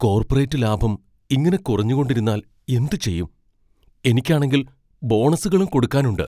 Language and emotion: Malayalam, fearful